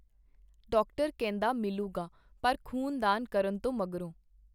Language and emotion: Punjabi, neutral